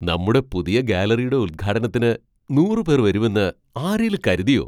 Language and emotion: Malayalam, surprised